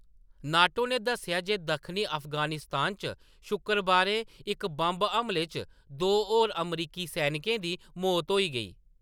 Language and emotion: Dogri, neutral